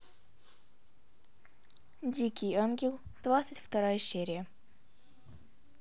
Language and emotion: Russian, neutral